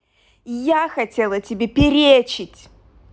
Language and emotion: Russian, angry